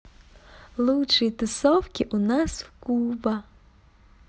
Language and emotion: Russian, positive